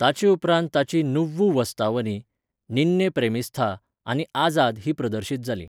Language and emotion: Goan Konkani, neutral